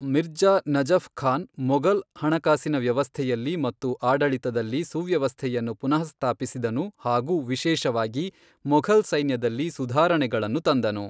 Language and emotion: Kannada, neutral